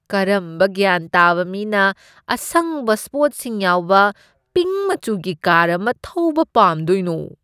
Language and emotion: Manipuri, disgusted